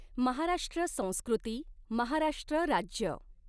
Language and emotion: Marathi, neutral